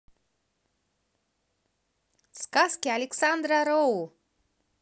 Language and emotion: Russian, positive